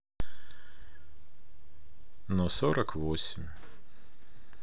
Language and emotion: Russian, sad